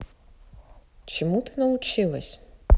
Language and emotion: Russian, neutral